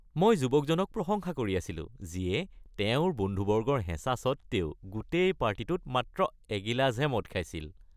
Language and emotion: Assamese, happy